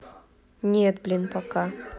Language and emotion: Russian, neutral